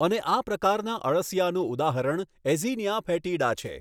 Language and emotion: Gujarati, neutral